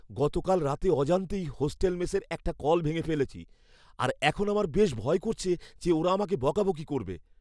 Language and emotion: Bengali, fearful